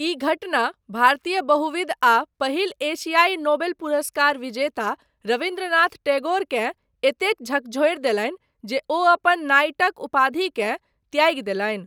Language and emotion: Maithili, neutral